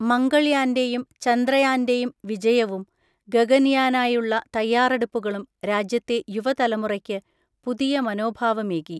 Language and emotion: Malayalam, neutral